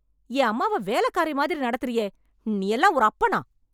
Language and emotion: Tamil, angry